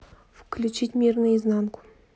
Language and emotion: Russian, neutral